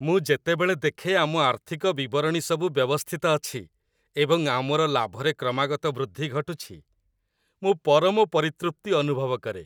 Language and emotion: Odia, happy